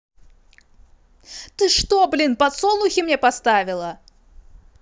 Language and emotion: Russian, angry